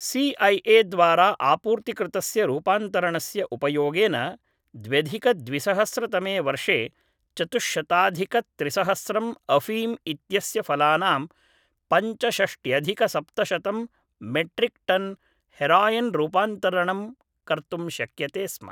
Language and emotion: Sanskrit, neutral